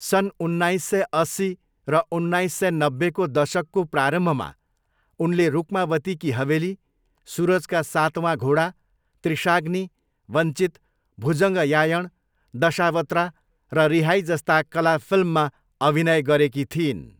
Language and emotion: Nepali, neutral